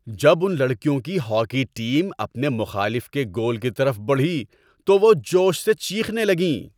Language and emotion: Urdu, happy